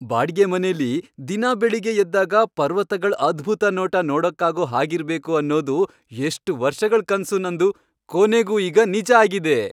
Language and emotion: Kannada, happy